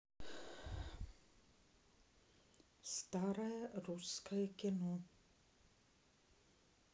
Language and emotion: Russian, neutral